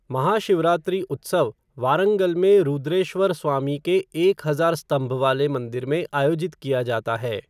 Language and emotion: Hindi, neutral